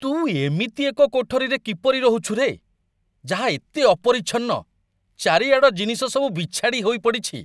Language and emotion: Odia, disgusted